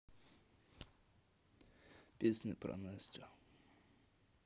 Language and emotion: Russian, neutral